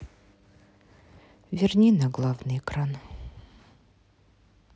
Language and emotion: Russian, sad